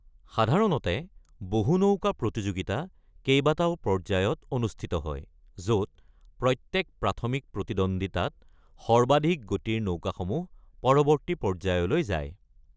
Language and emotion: Assamese, neutral